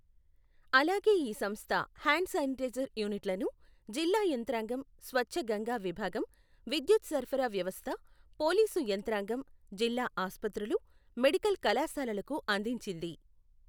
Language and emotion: Telugu, neutral